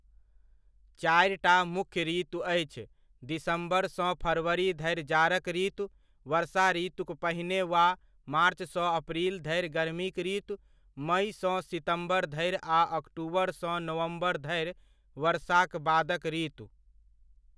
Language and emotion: Maithili, neutral